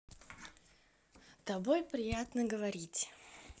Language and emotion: Russian, positive